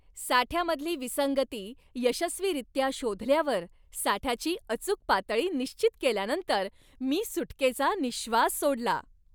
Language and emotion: Marathi, happy